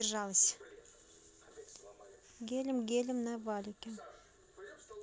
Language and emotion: Russian, neutral